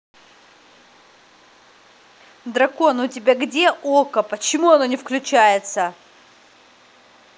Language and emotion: Russian, angry